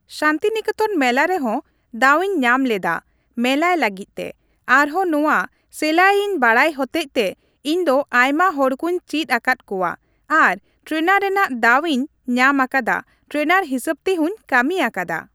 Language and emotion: Santali, neutral